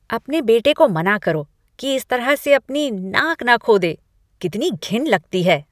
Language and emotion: Hindi, disgusted